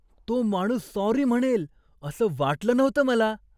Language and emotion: Marathi, surprised